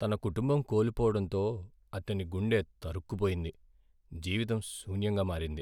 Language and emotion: Telugu, sad